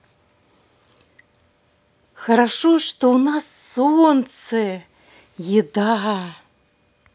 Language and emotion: Russian, positive